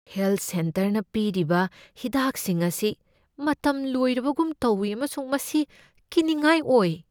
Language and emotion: Manipuri, fearful